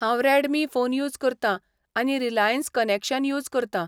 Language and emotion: Goan Konkani, neutral